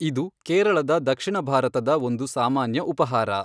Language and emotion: Kannada, neutral